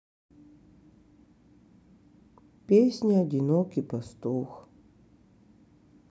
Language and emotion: Russian, sad